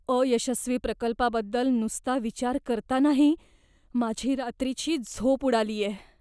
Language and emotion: Marathi, fearful